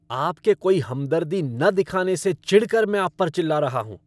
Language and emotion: Hindi, angry